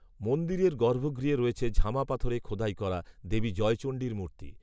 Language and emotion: Bengali, neutral